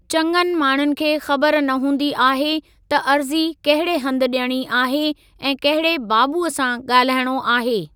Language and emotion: Sindhi, neutral